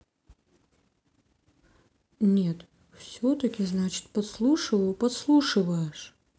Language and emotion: Russian, sad